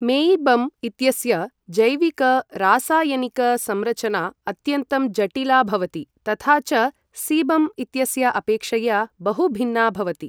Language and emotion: Sanskrit, neutral